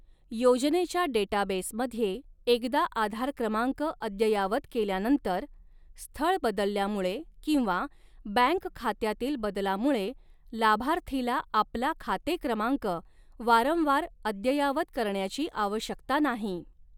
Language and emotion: Marathi, neutral